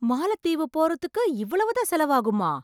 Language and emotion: Tamil, surprised